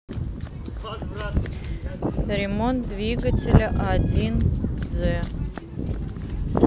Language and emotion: Russian, neutral